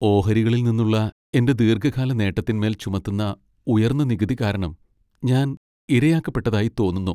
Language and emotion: Malayalam, sad